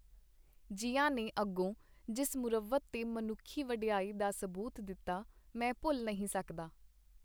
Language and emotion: Punjabi, neutral